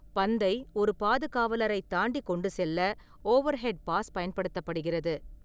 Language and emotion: Tamil, neutral